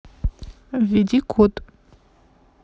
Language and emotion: Russian, neutral